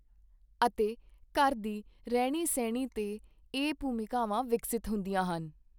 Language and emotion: Punjabi, neutral